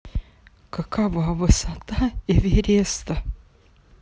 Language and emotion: Russian, sad